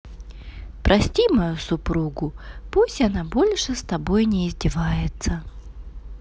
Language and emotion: Russian, positive